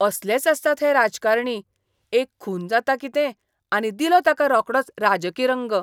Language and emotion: Goan Konkani, disgusted